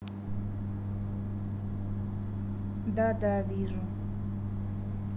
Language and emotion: Russian, neutral